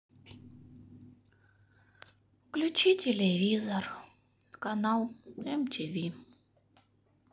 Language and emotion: Russian, sad